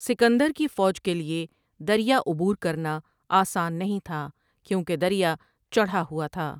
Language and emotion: Urdu, neutral